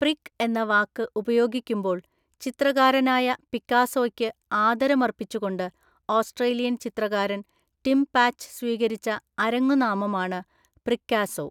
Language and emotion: Malayalam, neutral